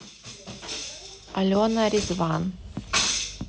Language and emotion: Russian, neutral